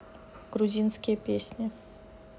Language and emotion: Russian, neutral